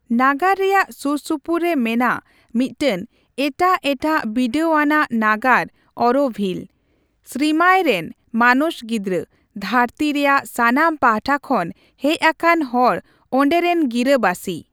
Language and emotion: Santali, neutral